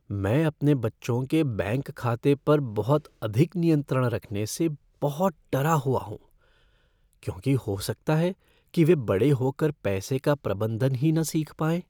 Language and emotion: Hindi, fearful